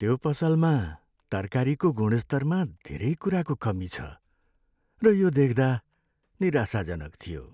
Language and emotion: Nepali, sad